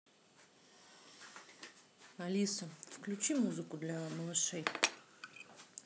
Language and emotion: Russian, neutral